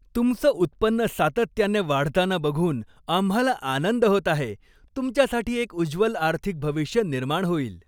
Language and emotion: Marathi, happy